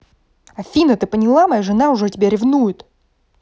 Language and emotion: Russian, angry